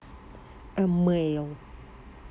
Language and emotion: Russian, neutral